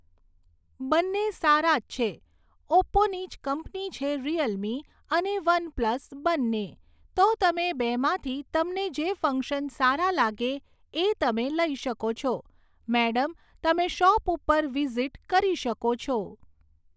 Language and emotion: Gujarati, neutral